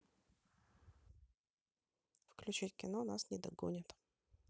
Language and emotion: Russian, neutral